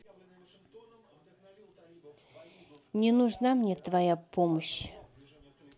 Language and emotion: Russian, sad